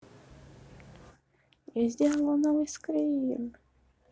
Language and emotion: Russian, positive